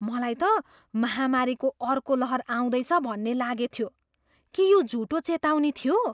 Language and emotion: Nepali, surprised